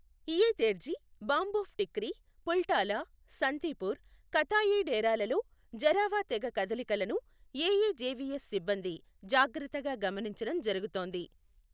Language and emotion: Telugu, neutral